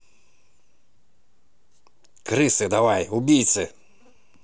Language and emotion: Russian, angry